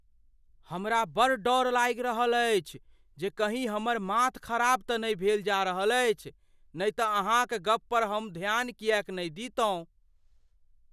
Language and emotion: Maithili, fearful